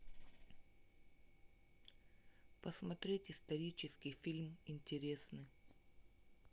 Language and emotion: Russian, neutral